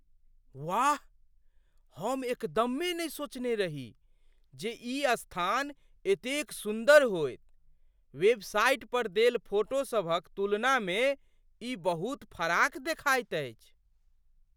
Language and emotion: Maithili, surprised